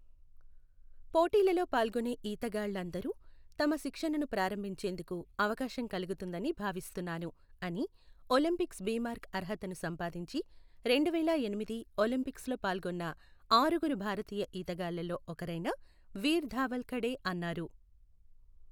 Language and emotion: Telugu, neutral